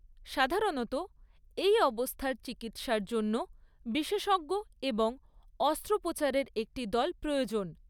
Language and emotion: Bengali, neutral